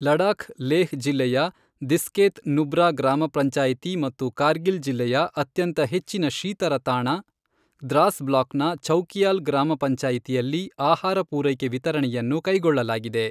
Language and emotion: Kannada, neutral